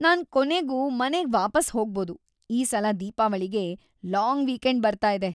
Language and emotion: Kannada, happy